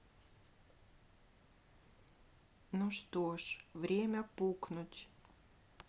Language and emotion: Russian, sad